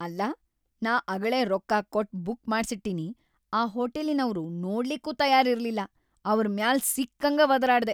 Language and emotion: Kannada, angry